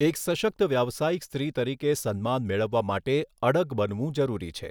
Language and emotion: Gujarati, neutral